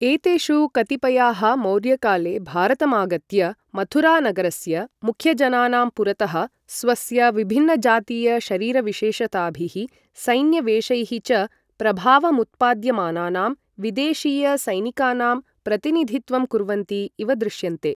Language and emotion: Sanskrit, neutral